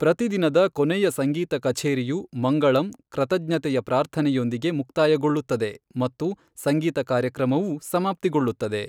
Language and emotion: Kannada, neutral